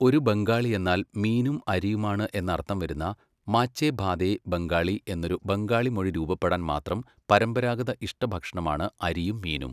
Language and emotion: Malayalam, neutral